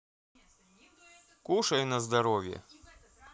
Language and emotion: Russian, neutral